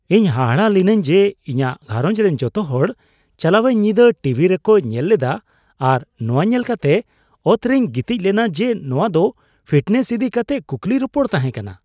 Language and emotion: Santali, surprised